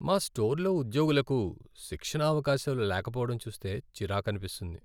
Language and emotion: Telugu, sad